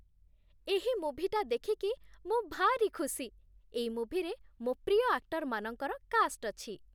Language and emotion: Odia, happy